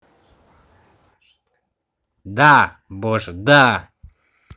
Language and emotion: Russian, angry